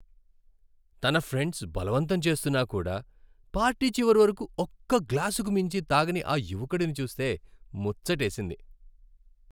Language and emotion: Telugu, happy